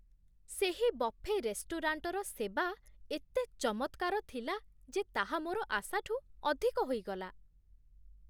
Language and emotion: Odia, surprised